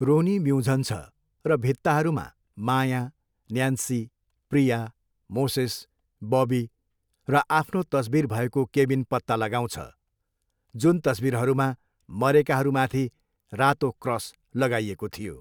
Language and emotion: Nepali, neutral